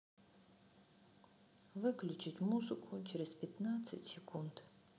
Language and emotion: Russian, sad